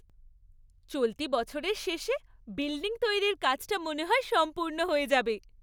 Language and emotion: Bengali, happy